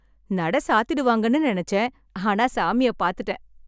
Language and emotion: Tamil, happy